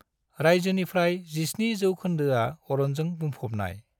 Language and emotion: Bodo, neutral